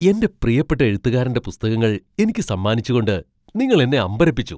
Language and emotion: Malayalam, surprised